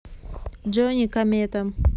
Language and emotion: Russian, neutral